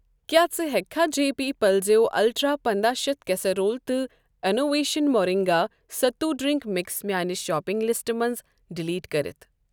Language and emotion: Kashmiri, neutral